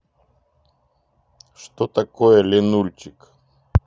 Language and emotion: Russian, neutral